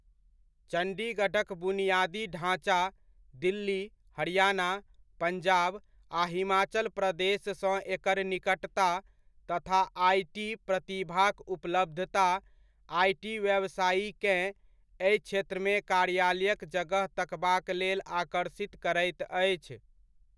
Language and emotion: Maithili, neutral